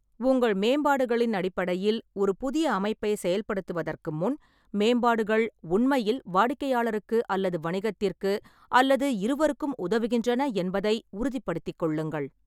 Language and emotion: Tamil, neutral